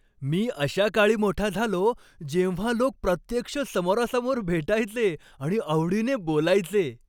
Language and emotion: Marathi, happy